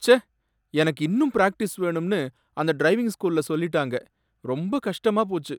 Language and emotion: Tamil, sad